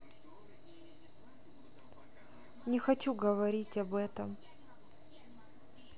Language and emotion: Russian, sad